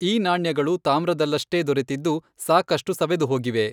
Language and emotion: Kannada, neutral